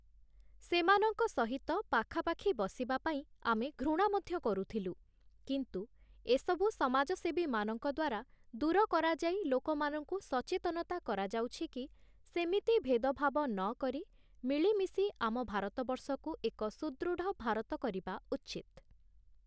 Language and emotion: Odia, neutral